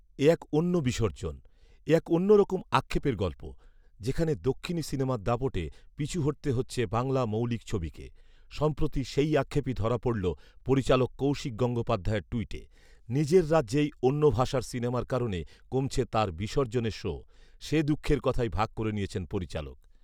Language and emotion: Bengali, neutral